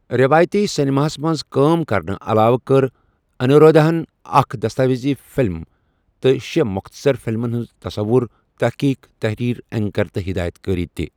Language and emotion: Kashmiri, neutral